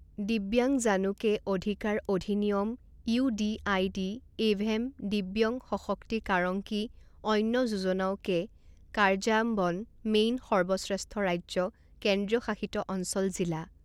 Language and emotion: Assamese, neutral